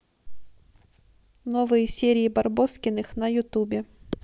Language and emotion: Russian, neutral